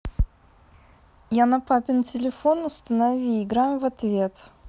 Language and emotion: Russian, neutral